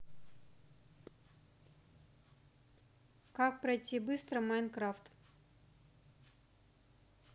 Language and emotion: Russian, neutral